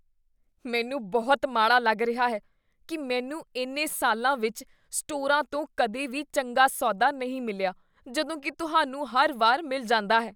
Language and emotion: Punjabi, disgusted